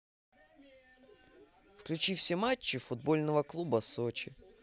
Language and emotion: Russian, positive